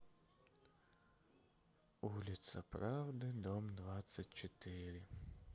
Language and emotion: Russian, sad